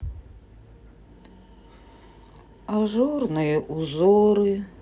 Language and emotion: Russian, sad